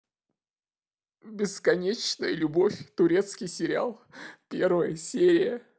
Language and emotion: Russian, sad